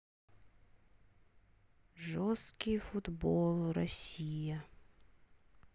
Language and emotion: Russian, sad